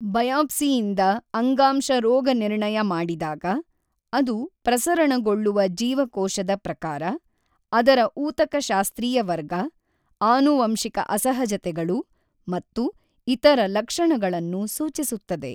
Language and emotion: Kannada, neutral